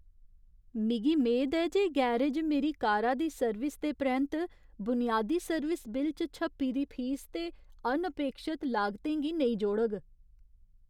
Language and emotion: Dogri, fearful